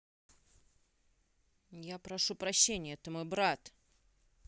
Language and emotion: Russian, neutral